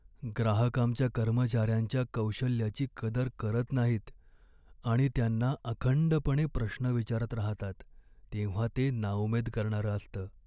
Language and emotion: Marathi, sad